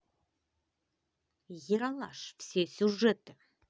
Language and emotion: Russian, positive